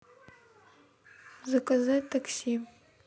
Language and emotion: Russian, neutral